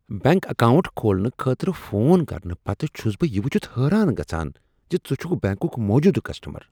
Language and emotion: Kashmiri, surprised